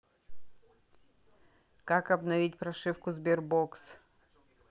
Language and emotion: Russian, neutral